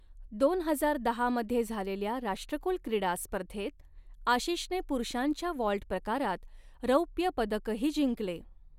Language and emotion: Marathi, neutral